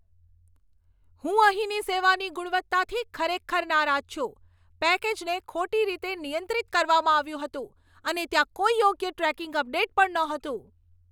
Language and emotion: Gujarati, angry